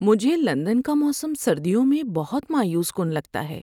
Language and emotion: Urdu, sad